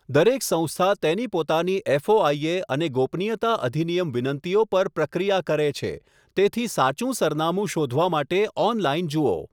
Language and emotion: Gujarati, neutral